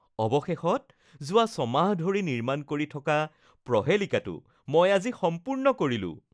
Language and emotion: Assamese, happy